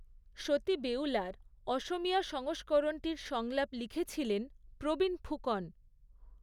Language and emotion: Bengali, neutral